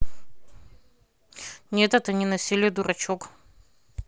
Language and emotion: Russian, neutral